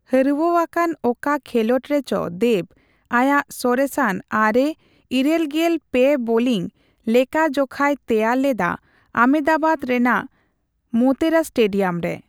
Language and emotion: Santali, neutral